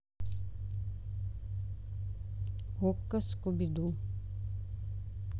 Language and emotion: Russian, neutral